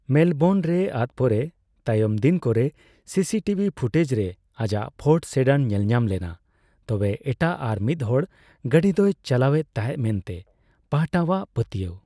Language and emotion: Santali, neutral